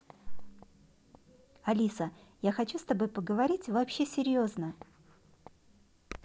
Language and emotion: Russian, positive